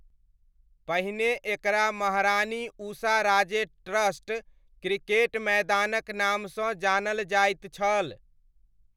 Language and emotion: Maithili, neutral